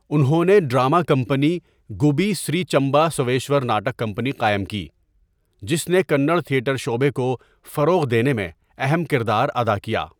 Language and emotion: Urdu, neutral